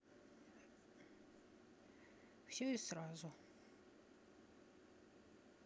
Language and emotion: Russian, sad